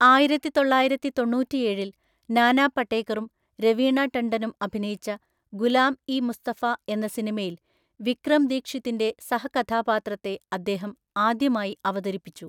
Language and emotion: Malayalam, neutral